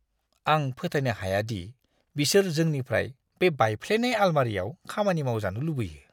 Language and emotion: Bodo, disgusted